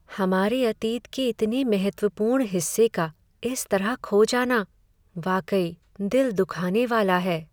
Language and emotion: Hindi, sad